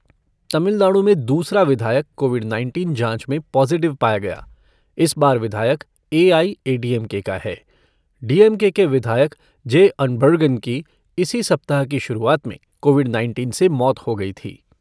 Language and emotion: Hindi, neutral